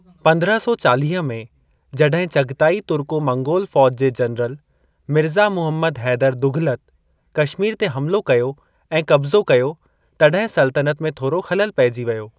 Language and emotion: Sindhi, neutral